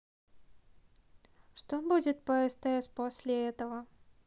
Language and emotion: Russian, neutral